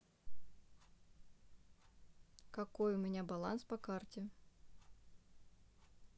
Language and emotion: Russian, neutral